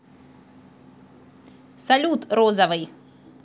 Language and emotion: Russian, positive